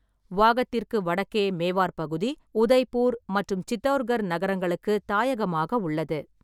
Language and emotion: Tamil, neutral